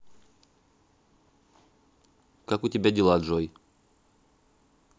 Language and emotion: Russian, neutral